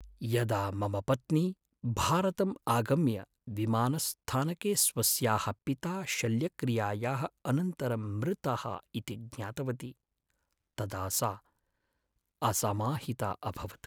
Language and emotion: Sanskrit, sad